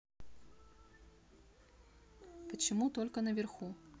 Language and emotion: Russian, neutral